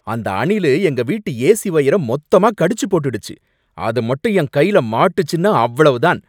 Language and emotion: Tamil, angry